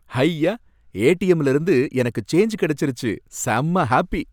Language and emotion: Tamil, happy